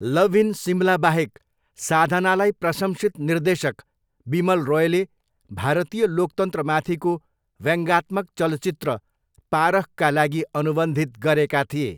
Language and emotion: Nepali, neutral